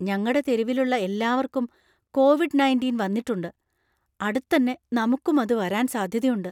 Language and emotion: Malayalam, fearful